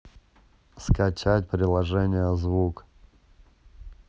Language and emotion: Russian, neutral